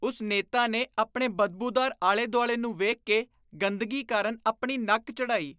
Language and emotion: Punjabi, disgusted